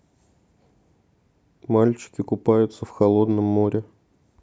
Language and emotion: Russian, neutral